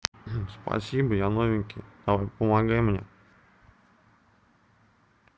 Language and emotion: Russian, neutral